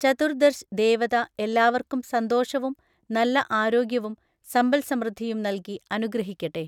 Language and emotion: Malayalam, neutral